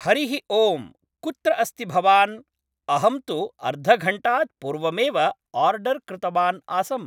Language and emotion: Sanskrit, neutral